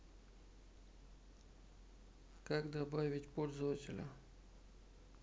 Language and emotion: Russian, neutral